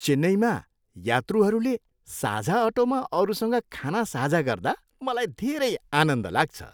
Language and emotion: Nepali, happy